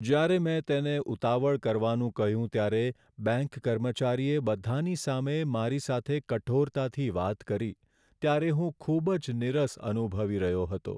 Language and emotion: Gujarati, sad